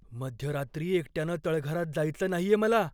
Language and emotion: Marathi, fearful